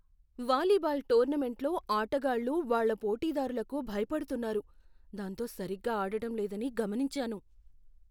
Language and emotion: Telugu, fearful